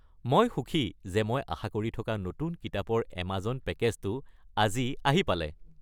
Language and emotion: Assamese, happy